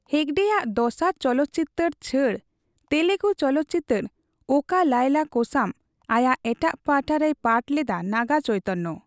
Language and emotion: Santali, neutral